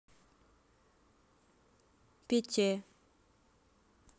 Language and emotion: Russian, neutral